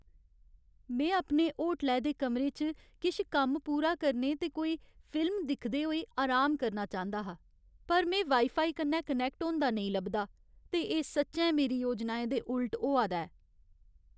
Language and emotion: Dogri, sad